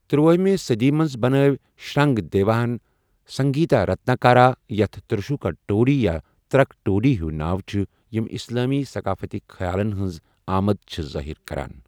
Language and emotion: Kashmiri, neutral